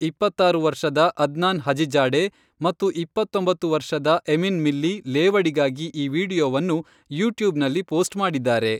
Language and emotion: Kannada, neutral